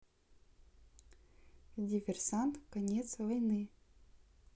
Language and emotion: Russian, neutral